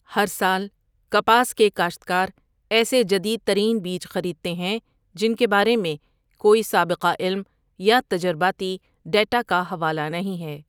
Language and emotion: Urdu, neutral